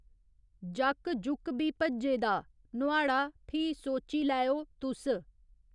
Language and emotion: Dogri, neutral